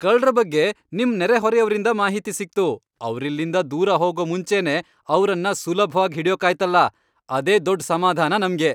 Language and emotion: Kannada, happy